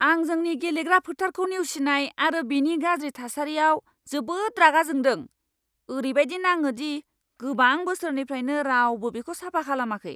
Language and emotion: Bodo, angry